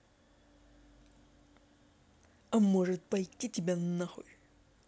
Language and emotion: Russian, angry